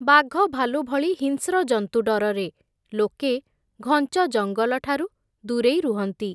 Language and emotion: Odia, neutral